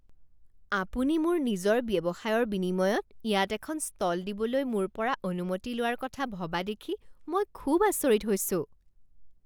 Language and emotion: Assamese, surprised